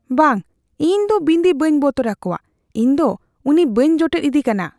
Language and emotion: Santali, fearful